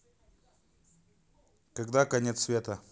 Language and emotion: Russian, neutral